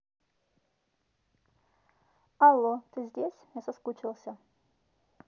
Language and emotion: Russian, neutral